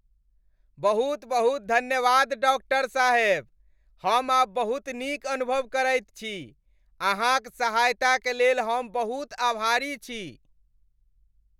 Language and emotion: Maithili, happy